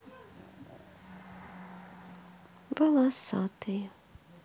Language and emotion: Russian, sad